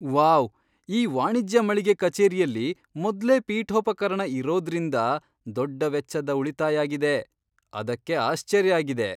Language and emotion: Kannada, surprised